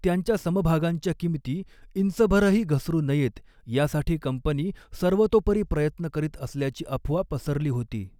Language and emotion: Marathi, neutral